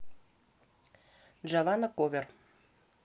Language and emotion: Russian, neutral